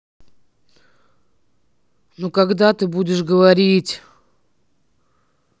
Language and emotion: Russian, sad